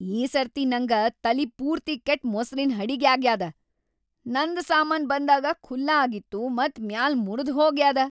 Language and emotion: Kannada, angry